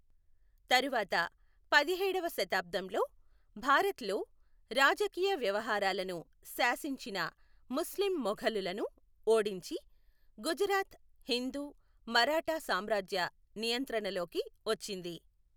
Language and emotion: Telugu, neutral